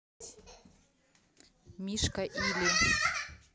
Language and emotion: Russian, neutral